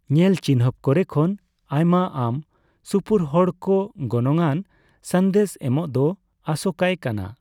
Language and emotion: Santali, neutral